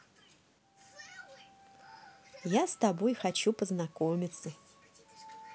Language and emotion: Russian, positive